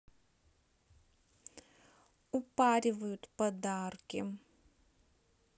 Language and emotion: Russian, neutral